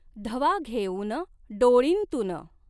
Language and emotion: Marathi, neutral